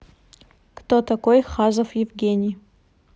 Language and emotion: Russian, neutral